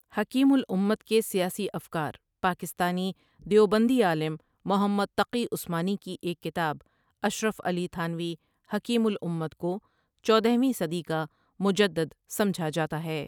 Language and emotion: Urdu, neutral